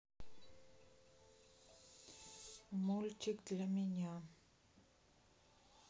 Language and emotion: Russian, sad